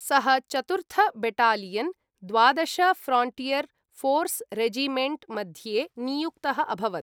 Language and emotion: Sanskrit, neutral